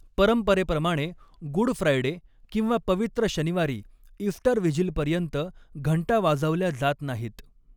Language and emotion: Marathi, neutral